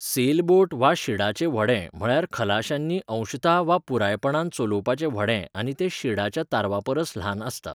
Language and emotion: Goan Konkani, neutral